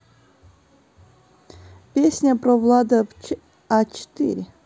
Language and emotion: Russian, neutral